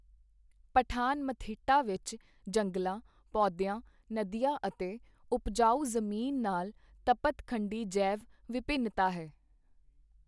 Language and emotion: Punjabi, neutral